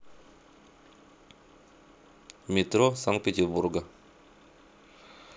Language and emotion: Russian, neutral